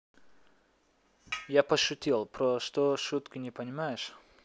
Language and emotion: Russian, neutral